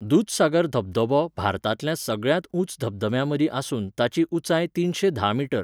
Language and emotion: Goan Konkani, neutral